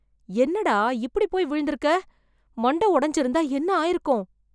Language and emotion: Tamil, fearful